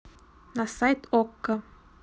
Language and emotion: Russian, neutral